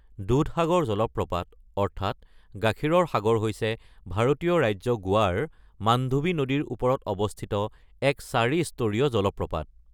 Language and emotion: Assamese, neutral